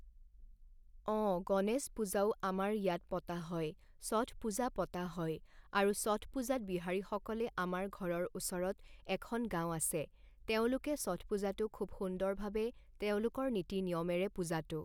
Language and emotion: Assamese, neutral